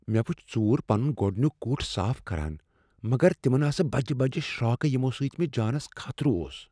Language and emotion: Kashmiri, fearful